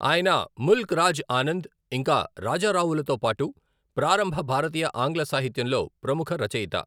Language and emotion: Telugu, neutral